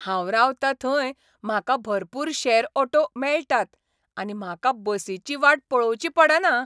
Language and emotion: Goan Konkani, happy